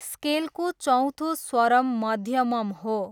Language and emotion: Nepali, neutral